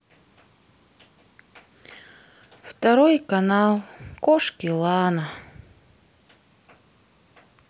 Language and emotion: Russian, sad